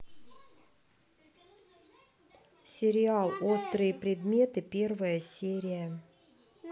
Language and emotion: Russian, neutral